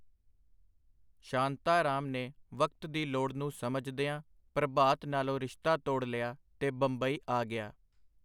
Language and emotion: Punjabi, neutral